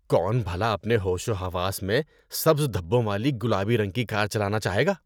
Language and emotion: Urdu, disgusted